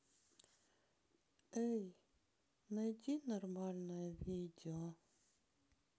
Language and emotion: Russian, sad